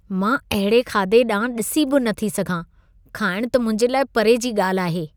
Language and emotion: Sindhi, disgusted